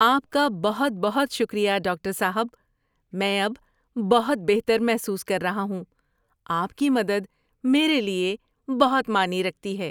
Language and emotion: Urdu, happy